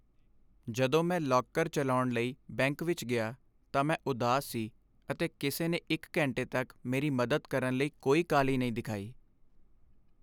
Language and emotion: Punjabi, sad